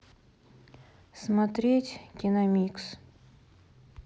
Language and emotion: Russian, neutral